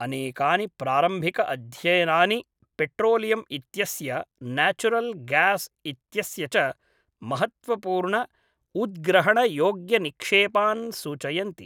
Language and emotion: Sanskrit, neutral